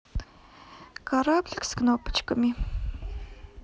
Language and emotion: Russian, neutral